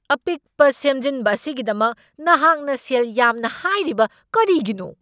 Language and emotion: Manipuri, angry